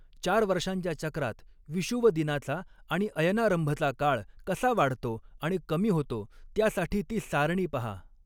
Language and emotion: Marathi, neutral